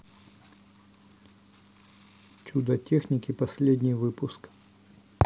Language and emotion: Russian, neutral